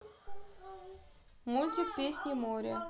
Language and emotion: Russian, neutral